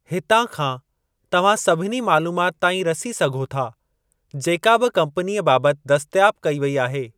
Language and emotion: Sindhi, neutral